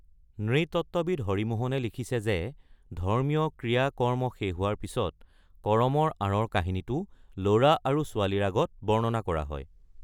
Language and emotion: Assamese, neutral